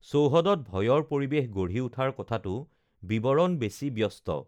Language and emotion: Assamese, neutral